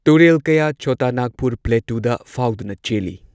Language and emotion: Manipuri, neutral